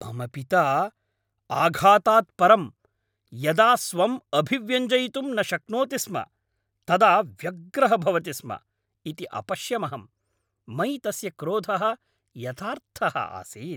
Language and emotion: Sanskrit, angry